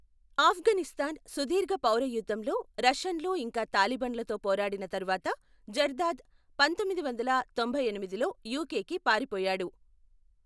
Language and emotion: Telugu, neutral